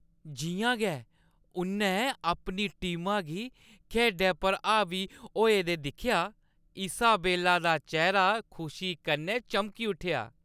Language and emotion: Dogri, happy